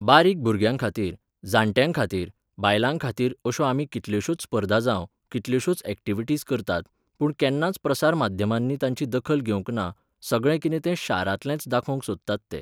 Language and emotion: Goan Konkani, neutral